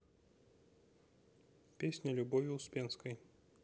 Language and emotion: Russian, neutral